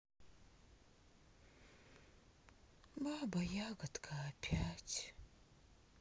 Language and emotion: Russian, sad